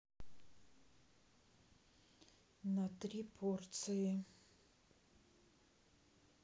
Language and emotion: Russian, neutral